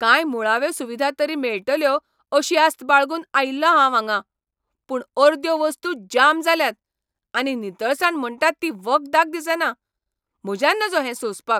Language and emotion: Goan Konkani, angry